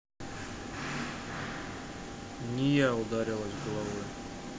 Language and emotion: Russian, neutral